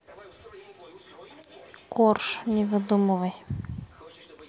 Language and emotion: Russian, neutral